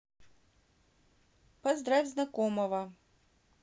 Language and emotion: Russian, neutral